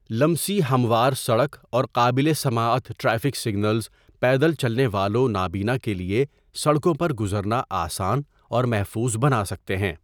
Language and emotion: Urdu, neutral